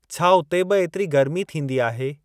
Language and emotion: Sindhi, neutral